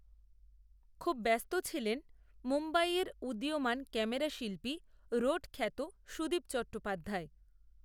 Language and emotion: Bengali, neutral